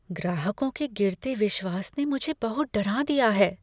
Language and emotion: Hindi, fearful